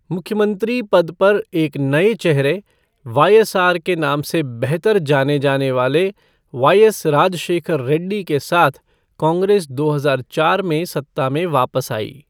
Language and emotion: Hindi, neutral